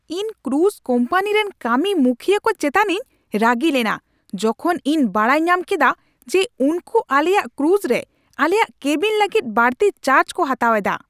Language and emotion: Santali, angry